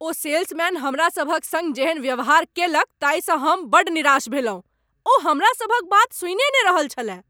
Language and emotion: Maithili, angry